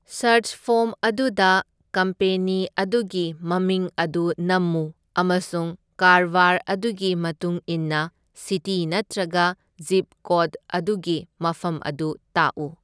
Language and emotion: Manipuri, neutral